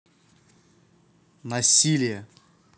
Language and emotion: Russian, neutral